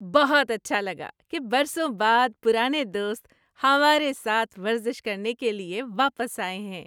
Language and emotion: Urdu, happy